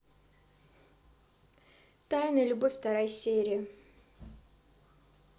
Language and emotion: Russian, neutral